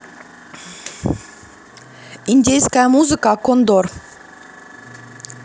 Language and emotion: Russian, positive